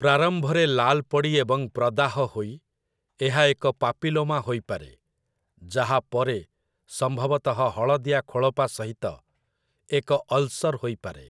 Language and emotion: Odia, neutral